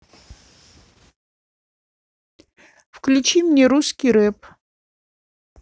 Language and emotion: Russian, neutral